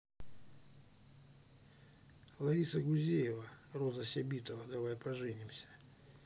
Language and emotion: Russian, neutral